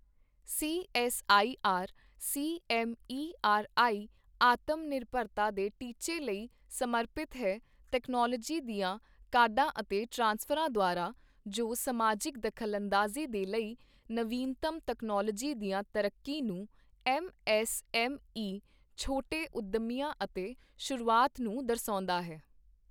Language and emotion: Punjabi, neutral